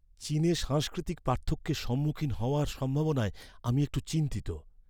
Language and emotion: Bengali, fearful